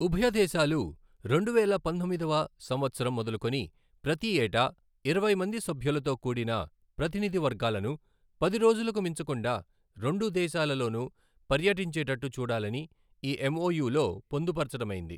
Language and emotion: Telugu, neutral